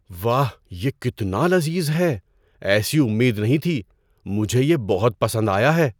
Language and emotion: Urdu, surprised